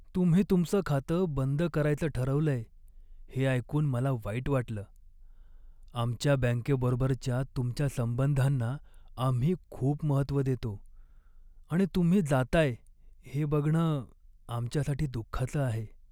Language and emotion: Marathi, sad